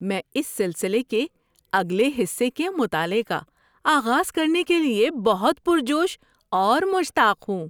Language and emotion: Urdu, happy